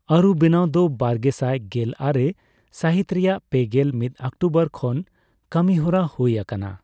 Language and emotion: Santali, neutral